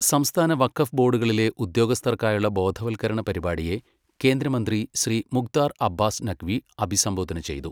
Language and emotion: Malayalam, neutral